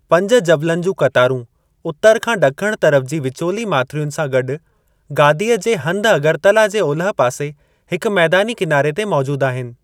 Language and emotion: Sindhi, neutral